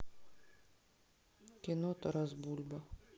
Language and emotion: Russian, sad